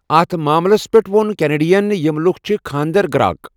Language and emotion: Kashmiri, neutral